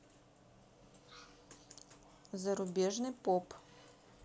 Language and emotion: Russian, neutral